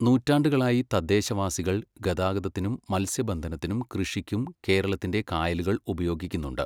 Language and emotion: Malayalam, neutral